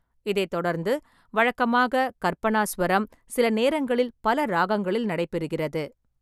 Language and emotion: Tamil, neutral